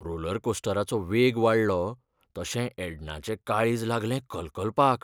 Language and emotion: Goan Konkani, fearful